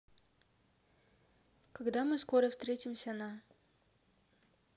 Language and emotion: Russian, neutral